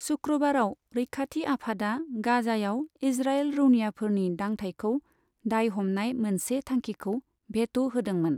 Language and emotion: Bodo, neutral